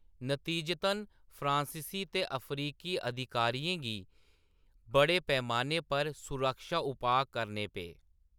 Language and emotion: Dogri, neutral